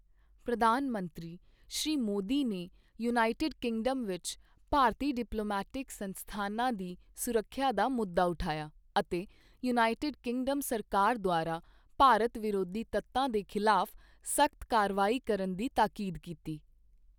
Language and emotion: Punjabi, neutral